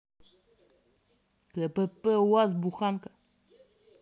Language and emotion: Russian, angry